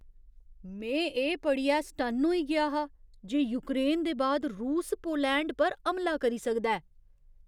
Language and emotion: Dogri, surprised